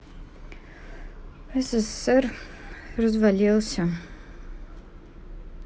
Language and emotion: Russian, sad